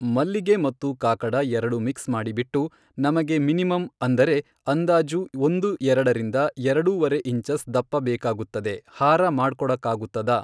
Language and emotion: Kannada, neutral